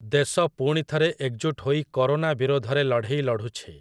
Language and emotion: Odia, neutral